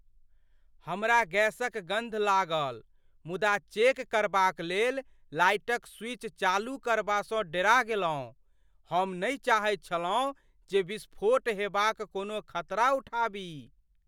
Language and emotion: Maithili, fearful